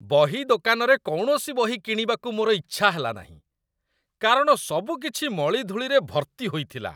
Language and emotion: Odia, disgusted